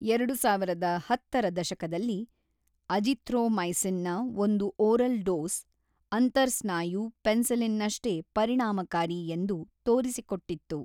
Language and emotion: Kannada, neutral